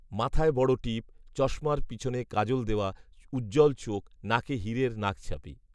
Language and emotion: Bengali, neutral